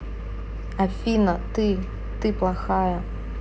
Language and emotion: Russian, neutral